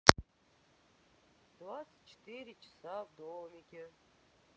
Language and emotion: Russian, sad